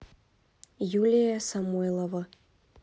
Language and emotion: Russian, neutral